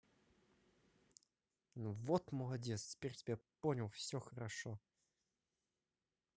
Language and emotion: Russian, positive